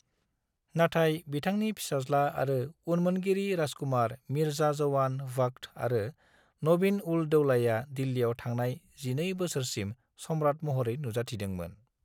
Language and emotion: Bodo, neutral